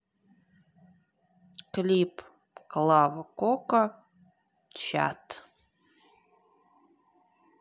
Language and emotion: Russian, neutral